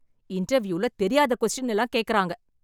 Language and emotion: Tamil, angry